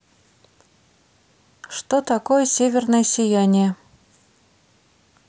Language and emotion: Russian, neutral